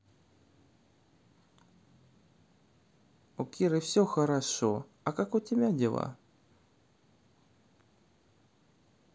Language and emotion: Russian, neutral